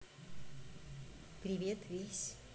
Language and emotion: Russian, neutral